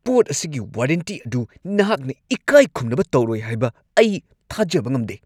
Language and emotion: Manipuri, angry